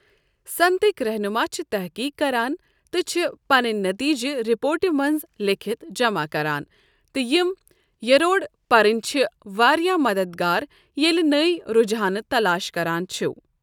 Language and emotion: Kashmiri, neutral